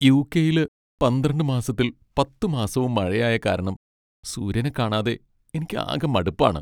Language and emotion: Malayalam, sad